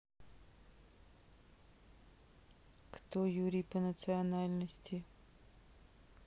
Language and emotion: Russian, neutral